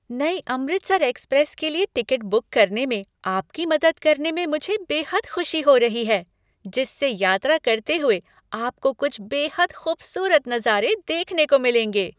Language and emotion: Hindi, happy